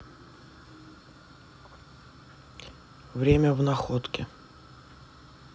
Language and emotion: Russian, neutral